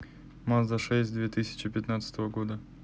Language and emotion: Russian, neutral